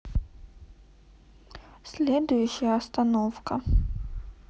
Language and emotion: Russian, sad